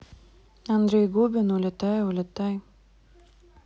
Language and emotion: Russian, neutral